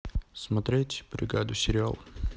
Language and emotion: Russian, neutral